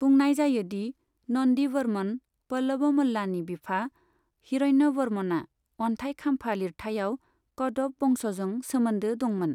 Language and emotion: Bodo, neutral